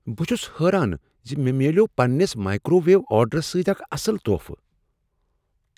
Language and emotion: Kashmiri, surprised